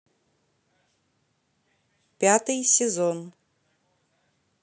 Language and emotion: Russian, neutral